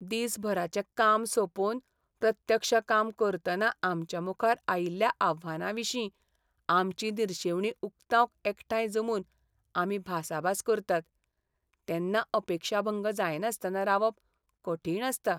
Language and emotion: Goan Konkani, sad